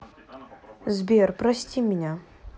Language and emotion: Russian, sad